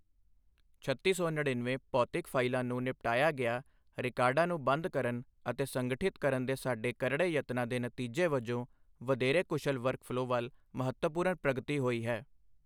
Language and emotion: Punjabi, neutral